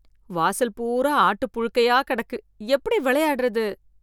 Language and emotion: Tamil, disgusted